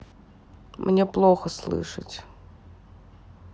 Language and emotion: Russian, sad